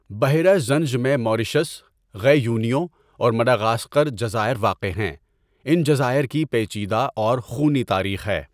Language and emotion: Urdu, neutral